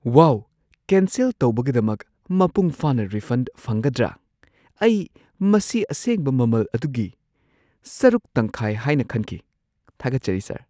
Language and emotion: Manipuri, surprised